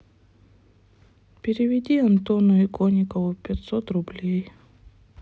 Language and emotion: Russian, sad